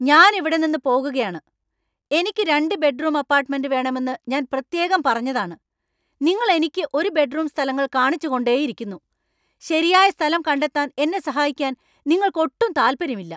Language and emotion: Malayalam, angry